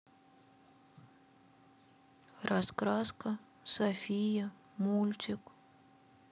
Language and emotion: Russian, sad